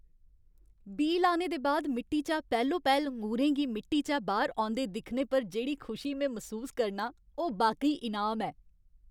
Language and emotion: Dogri, happy